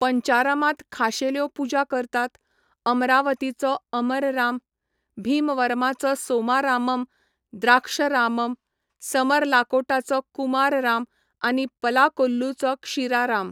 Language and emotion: Goan Konkani, neutral